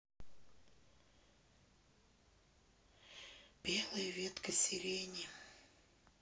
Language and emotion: Russian, sad